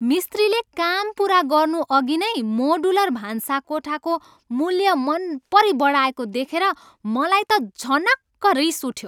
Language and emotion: Nepali, angry